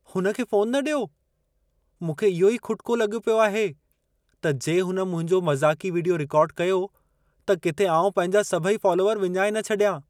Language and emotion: Sindhi, fearful